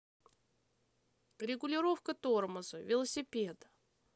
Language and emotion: Russian, neutral